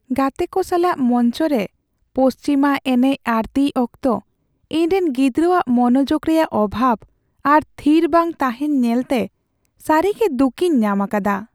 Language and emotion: Santali, sad